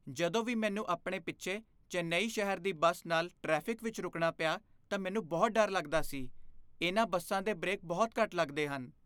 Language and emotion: Punjabi, fearful